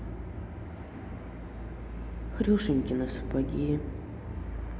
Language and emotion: Russian, sad